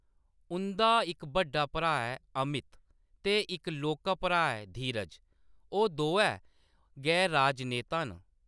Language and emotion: Dogri, neutral